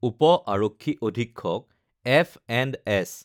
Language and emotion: Assamese, neutral